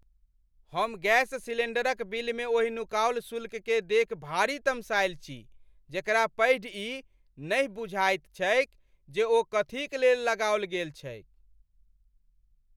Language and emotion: Maithili, angry